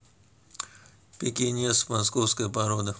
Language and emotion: Russian, neutral